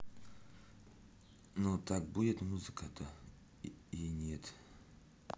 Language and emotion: Russian, neutral